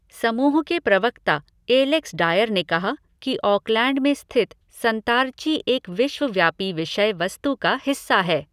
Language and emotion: Hindi, neutral